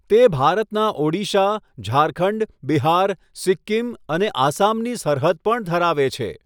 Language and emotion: Gujarati, neutral